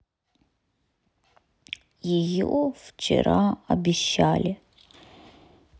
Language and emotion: Russian, neutral